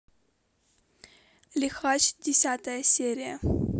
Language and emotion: Russian, neutral